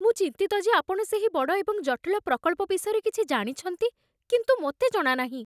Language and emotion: Odia, fearful